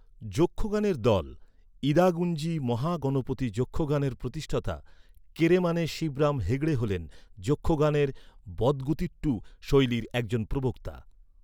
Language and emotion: Bengali, neutral